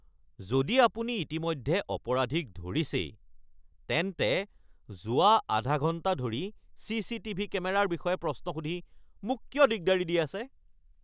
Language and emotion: Assamese, angry